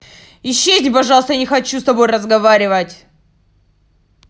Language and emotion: Russian, angry